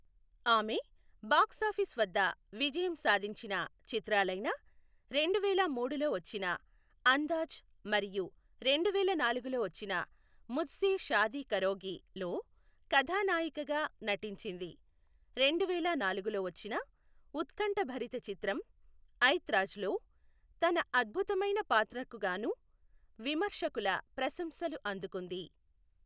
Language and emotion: Telugu, neutral